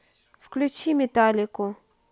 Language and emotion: Russian, neutral